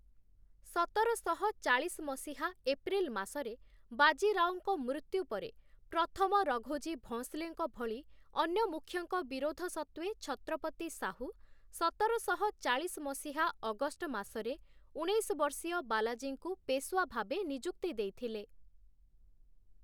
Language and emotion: Odia, neutral